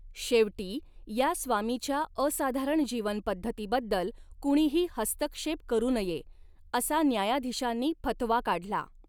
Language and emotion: Marathi, neutral